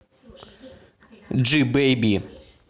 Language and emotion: Russian, neutral